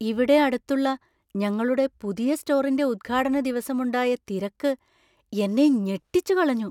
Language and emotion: Malayalam, surprised